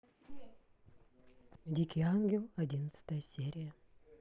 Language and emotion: Russian, neutral